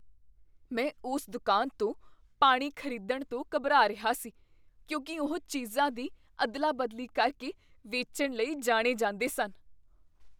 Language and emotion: Punjabi, fearful